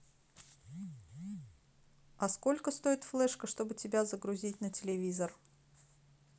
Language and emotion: Russian, neutral